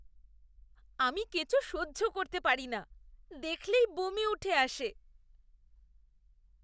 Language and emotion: Bengali, disgusted